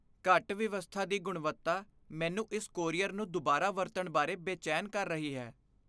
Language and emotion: Punjabi, fearful